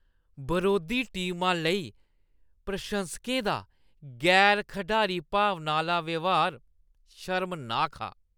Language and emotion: Dogri, disgusted